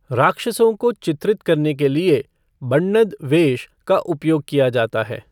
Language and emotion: Hindi, neutral